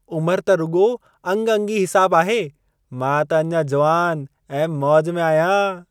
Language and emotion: Sindhi, happy